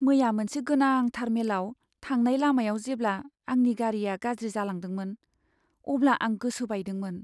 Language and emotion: Bodo, sad